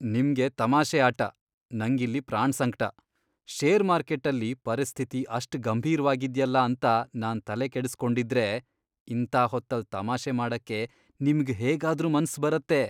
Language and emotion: Kannada, disgusted